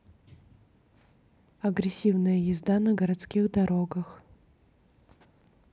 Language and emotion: Russian, neutral